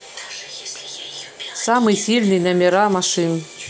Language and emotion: Russian, neutral